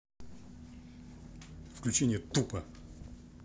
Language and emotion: Russian, angry